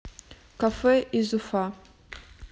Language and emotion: Russian, neutral